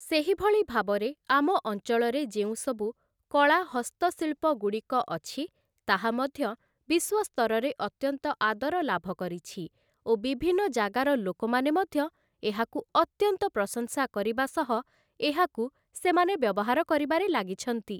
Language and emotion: Odia, neutral